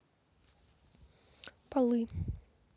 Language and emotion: Russian, neutral